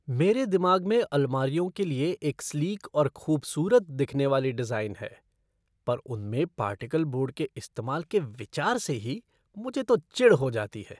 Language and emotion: Hindi, disgusted